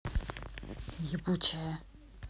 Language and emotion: Russian, angry